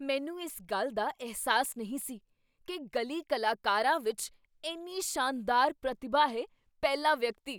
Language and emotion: Punjabi, surprised